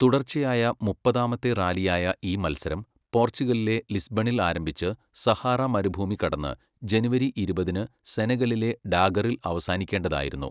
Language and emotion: Malayalam, neutral